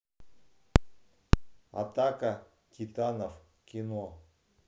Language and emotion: Russian, neutral